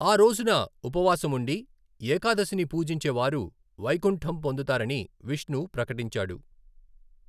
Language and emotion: Telugu, neutral